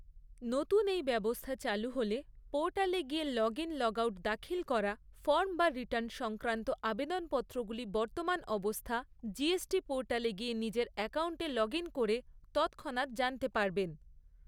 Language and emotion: Bengali, neutral